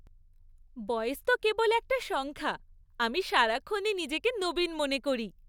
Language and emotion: Bengali, happy